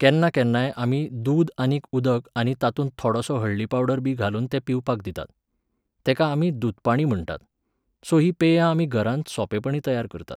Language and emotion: Goan Konkani, neutral